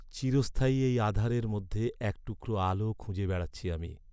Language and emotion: Bengali, sad